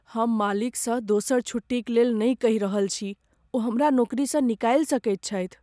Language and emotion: Maithili, fearful